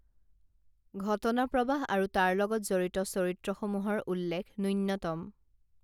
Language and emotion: Assamese, neutral